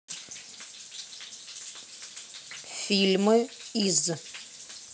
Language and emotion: Russian, neutral